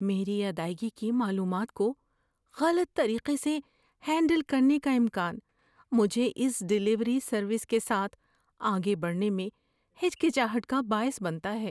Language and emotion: Urdu, fearful